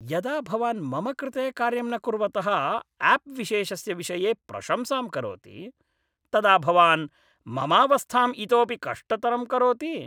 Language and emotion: Sanskrit, angry